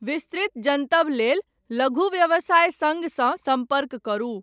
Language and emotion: Maithili, neutral